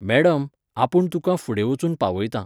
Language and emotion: Goan Konkani, neutral